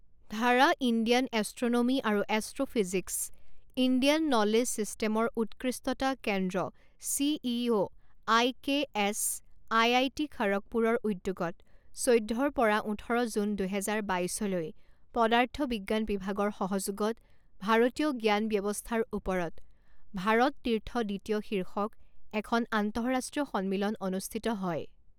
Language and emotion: Assamese, neutral